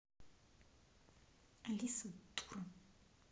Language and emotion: Russian, angry